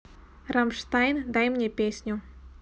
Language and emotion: Russian, neutral